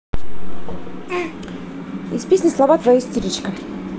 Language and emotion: Russian, neutral